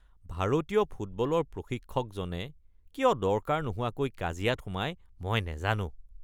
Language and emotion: Assamese, disgusted